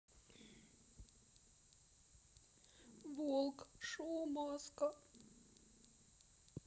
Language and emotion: Russian, sad